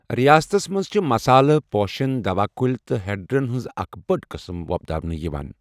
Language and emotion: Kashmiri, neutral